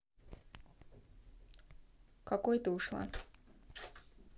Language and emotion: Russian, neutral